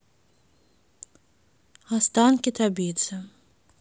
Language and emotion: Russian, neutral